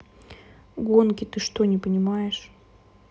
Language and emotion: Russian, neutral